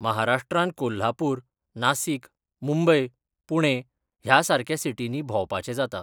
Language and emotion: Goan Konkani, neutral